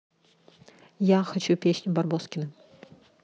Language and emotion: Russian, neutral